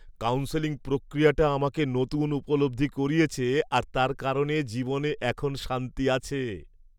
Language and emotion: Bengali, happy